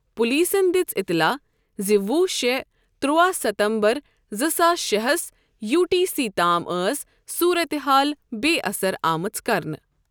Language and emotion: Kashmiri, neutral